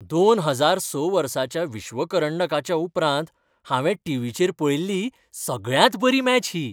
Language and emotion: Goan Konkani, happy